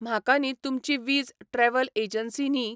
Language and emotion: Goan Konkani, neutral